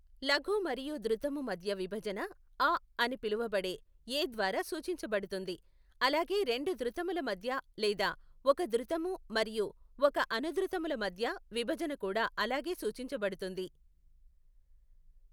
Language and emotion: Telugu, neutral